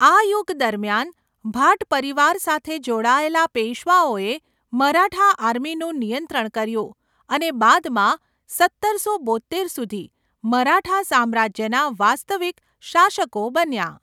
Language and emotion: Gujarati, neutral